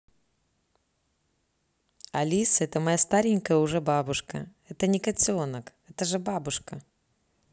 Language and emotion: Russian, neutral